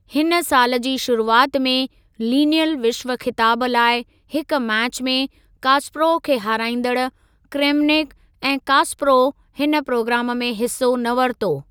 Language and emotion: Sindhi, neutral